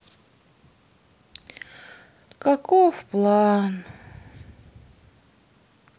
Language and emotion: Russian, sad